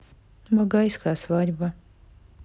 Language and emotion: Russian, neutral